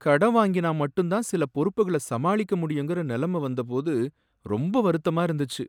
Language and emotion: Tamil, sad